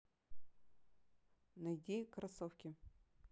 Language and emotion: Russian, neutral